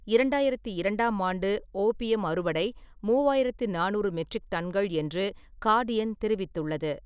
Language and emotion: Tamil, neutral